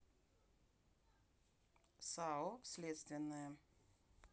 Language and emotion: Russian, neutral